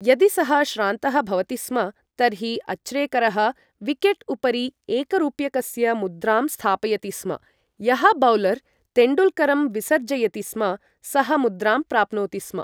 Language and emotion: Sanskrit, neutral